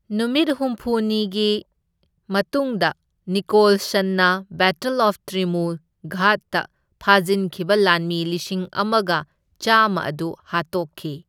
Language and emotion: Manipuri, neutral